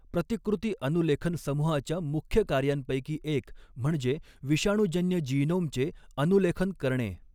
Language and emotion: Marathi, neutral